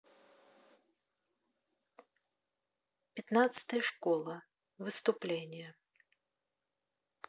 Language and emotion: Russian, neutral